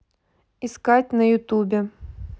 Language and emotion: Russian, neutral